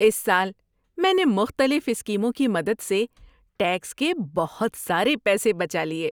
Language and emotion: Urdu, happy